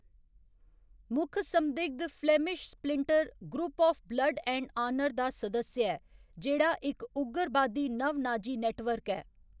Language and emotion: Dogri, neutral